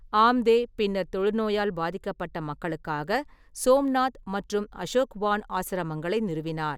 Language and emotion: Tamil, neutral